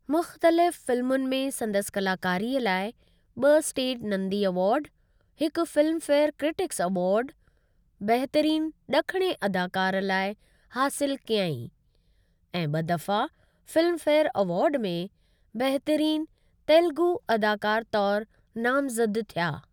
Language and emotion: Sindhi, neutral